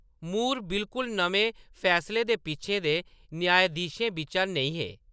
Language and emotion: Dogri, neutral